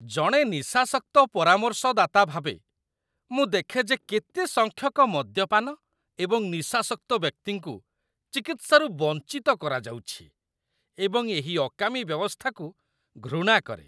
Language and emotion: Odia, disgusted